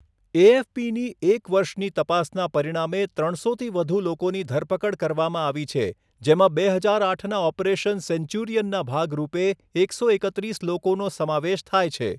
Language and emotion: Gujarati, neutral